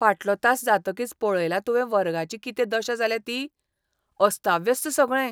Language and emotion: Goan Konkani, disgusted